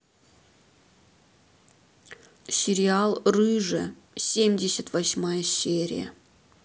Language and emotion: Russian, neutral